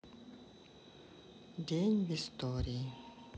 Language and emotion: Russian, sad